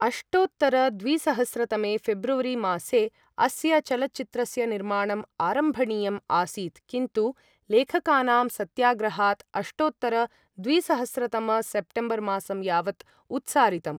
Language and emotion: Sanskrit, neutral